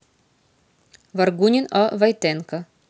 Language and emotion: Russian, neutral